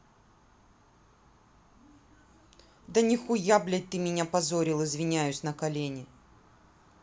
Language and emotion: Russian, angry